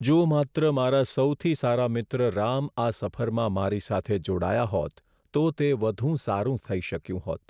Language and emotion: Gujarati, sad